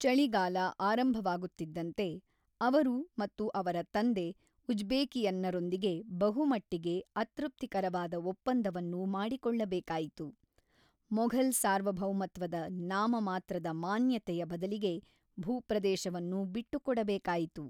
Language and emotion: Kannada, neutral